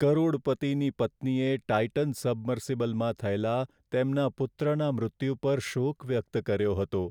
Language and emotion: Gujarati, sad